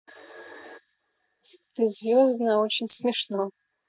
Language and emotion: Russian, positive